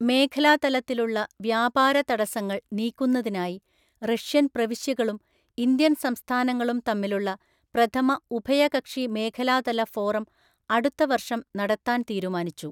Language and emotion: Malayalam, neutral